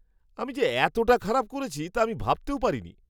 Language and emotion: Bengali, surprised